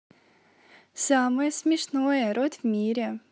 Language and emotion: Russian, positive